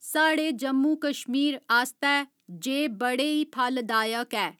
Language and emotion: Dogri, neutral